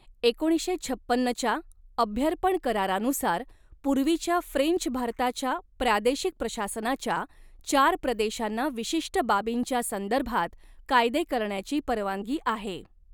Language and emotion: Marathi, neutral